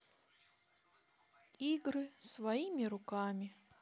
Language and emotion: Russian, sad